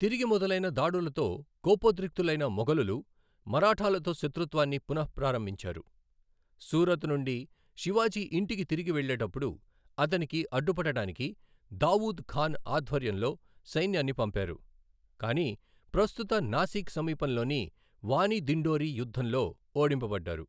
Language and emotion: Telugu, neutral